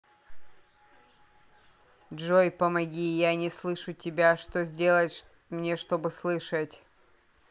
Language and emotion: Russian, neutral